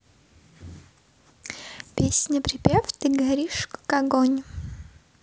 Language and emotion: Russian, positive